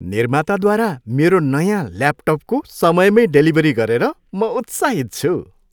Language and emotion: Nepali, happy